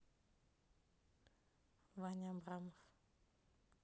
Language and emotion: Russian, neutral